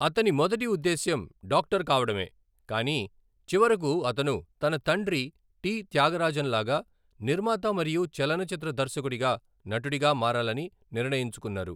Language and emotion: Telugu, neutral